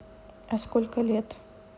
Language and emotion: Russian, neutral